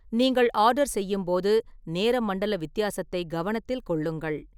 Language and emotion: Tamil, neutral